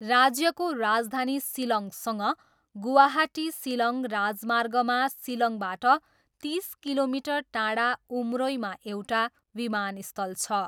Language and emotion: Nepali, neutral